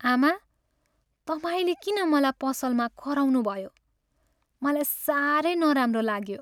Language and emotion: Nepali, sad